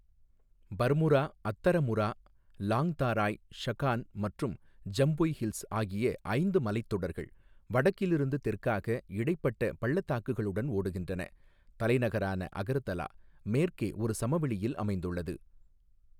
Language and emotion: Tamil, neutral